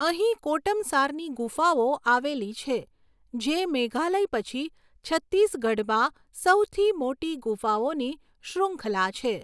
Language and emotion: Gujarati, neutral